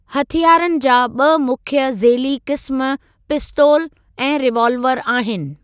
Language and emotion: Sindhi, neutral